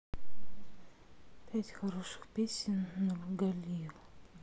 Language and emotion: Russian, sad